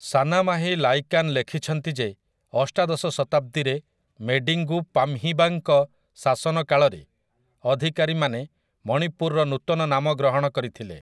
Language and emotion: Odia, neutral